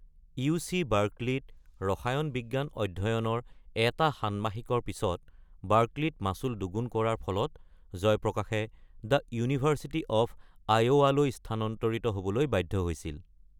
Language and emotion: Assamese, neutral